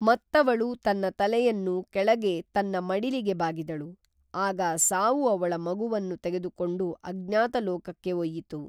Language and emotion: Kannada, neutral